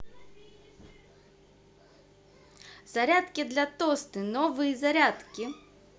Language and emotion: Russian, positive